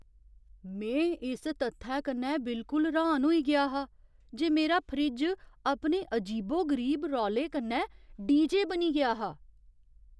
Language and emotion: Dogri, surprised